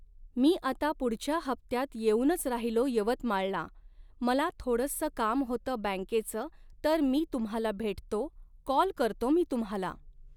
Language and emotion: Marathi, neutral